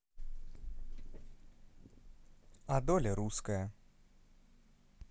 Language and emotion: Russian, neutral